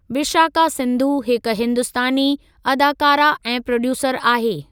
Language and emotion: Sindhi, neutral